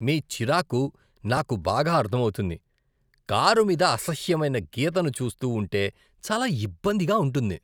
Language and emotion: Telugu, disgusted